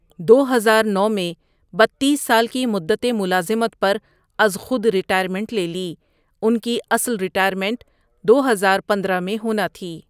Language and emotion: Urdu, neutral